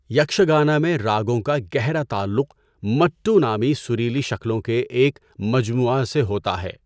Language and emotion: Urdu, neutral